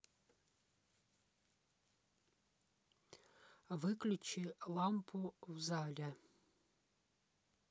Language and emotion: Russian, neutral